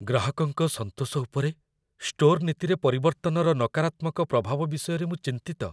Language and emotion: Odia, fearful